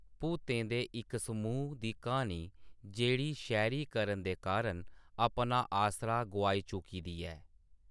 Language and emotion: Dogri, neutral